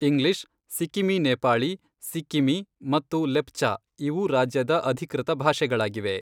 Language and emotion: Kannada, neutral